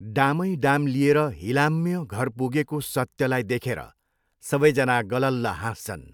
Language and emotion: Nepali, neutral